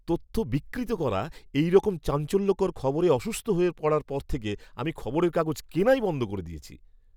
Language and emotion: Bengali, disgusted